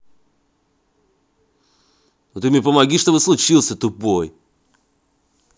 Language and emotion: Russian, angry